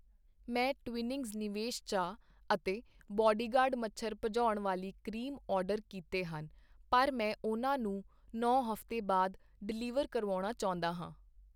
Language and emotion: Punjabi, neutral